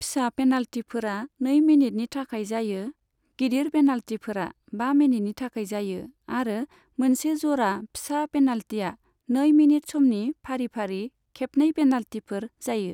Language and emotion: Bodo, neutral